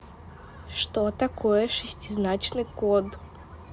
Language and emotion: Russian, neutral